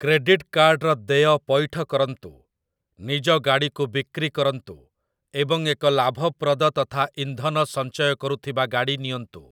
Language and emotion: Odia, neutral